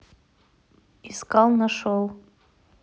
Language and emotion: Russian, neutral